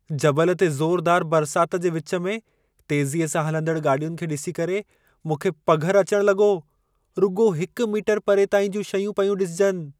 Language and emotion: Sindhi, fearful